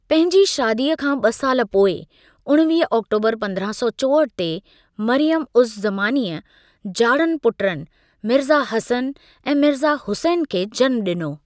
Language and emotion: Sindhi, neutral